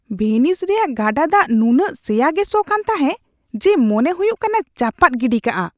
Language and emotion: Santali, disgusted